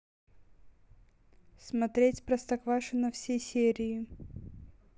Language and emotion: Russian, neutral